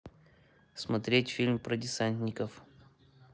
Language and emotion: Russian, neutral